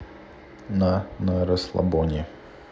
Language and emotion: Russian, neutral